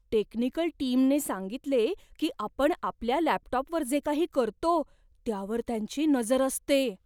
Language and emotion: Marathi, fearful